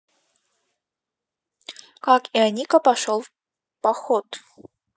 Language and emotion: Russian, neutral